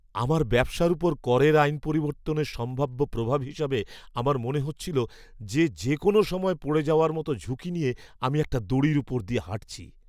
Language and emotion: Bengali, fearful